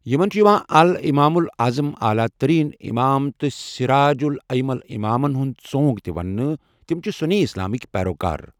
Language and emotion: Kashmiri, neutral